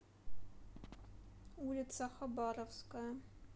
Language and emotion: Russian, neutral